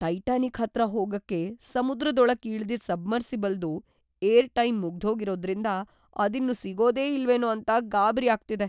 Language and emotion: Kannada, fearful